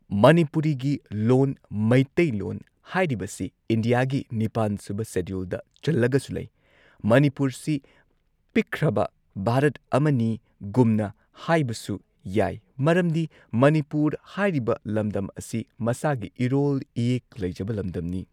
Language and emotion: Manipuri, neutral